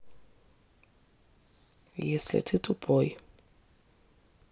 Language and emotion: Russian, neutral